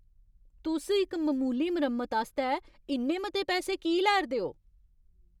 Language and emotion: Dogri, angry